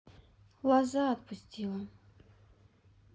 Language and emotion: Russian, sad